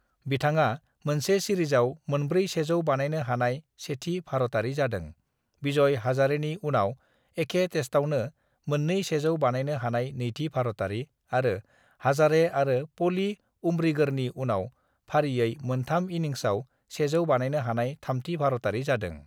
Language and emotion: Bodo, neutral